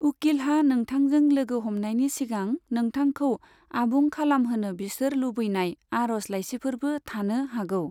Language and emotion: Bodo, neutral